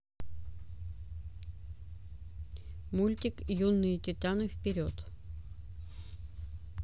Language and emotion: Russian, neutral